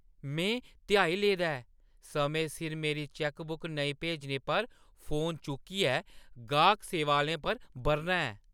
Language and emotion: Dogri, angry